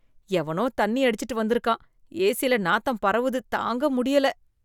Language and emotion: Tamil, disgusted